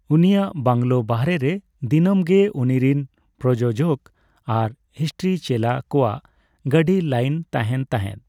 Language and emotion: Santali, neutral